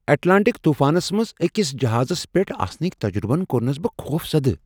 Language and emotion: Kashmiri, surprised